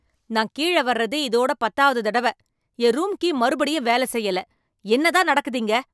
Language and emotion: Tamil, angry